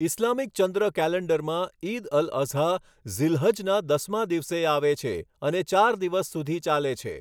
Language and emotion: Gujarati, neutral